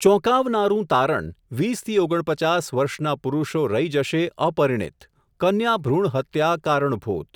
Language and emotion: Gujarati, neutral